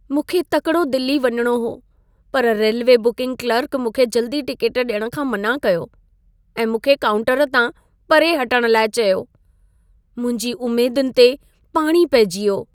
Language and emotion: Sindhi, sad